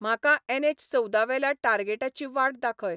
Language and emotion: Goan Konkani, neutral